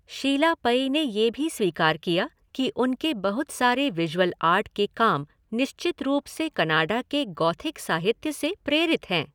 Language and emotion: Hindi, neutral